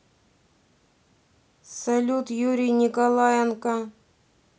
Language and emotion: Russian, neutral